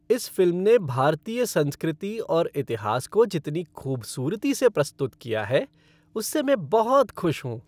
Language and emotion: Hindi, happy